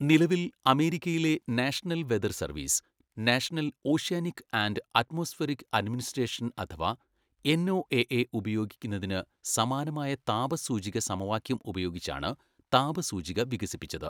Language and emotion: Malayalam, neutral